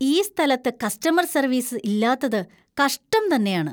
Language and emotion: Malayalam, disgusted